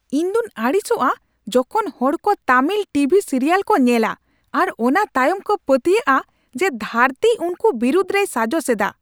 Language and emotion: Santali, angry